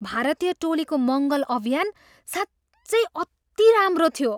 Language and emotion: Nepali, surprised